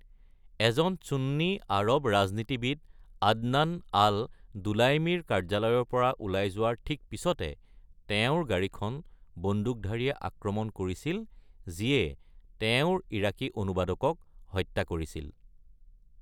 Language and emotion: Assamese, neutral